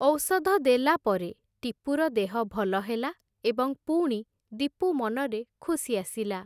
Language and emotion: Odia, neutral